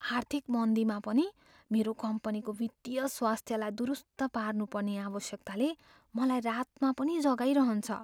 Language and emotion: Nepali, fearful